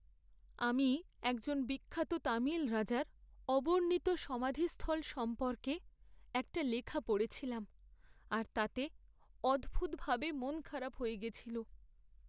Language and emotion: Bengali, sad